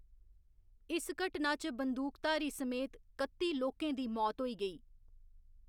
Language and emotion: Dogri, neutral